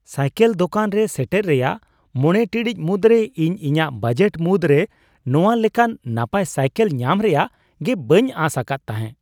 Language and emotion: Santali, surprised